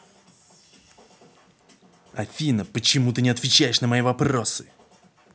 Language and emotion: Russian, angry